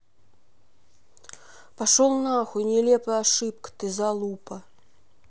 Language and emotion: Russian, angry